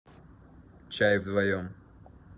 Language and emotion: Russian, neutral